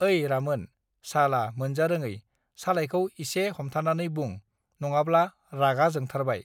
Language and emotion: Bodo, neutral